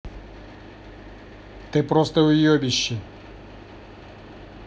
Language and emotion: Russian, angry